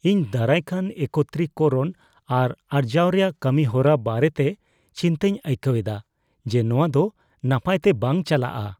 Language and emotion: Santali, fearful